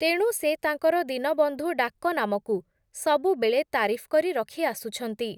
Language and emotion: Odia, neutral